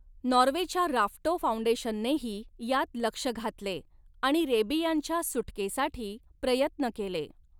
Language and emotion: Marathi, neutral